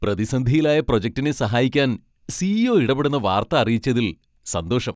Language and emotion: Malayalam, happy